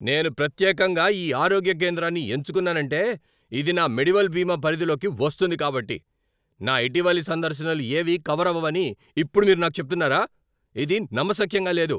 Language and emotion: Telugu, angry